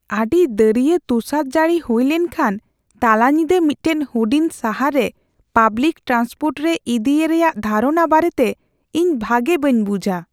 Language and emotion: Santali, fearful